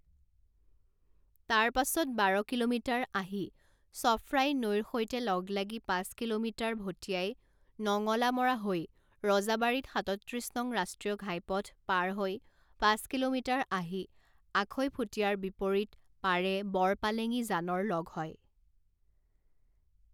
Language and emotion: Assamese, neutral